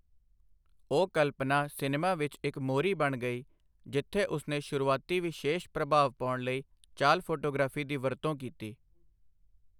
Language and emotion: Punjabi, neutral